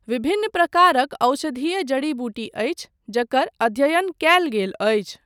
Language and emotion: Maithili, neutral